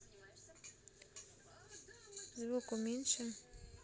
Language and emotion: Russian, neutral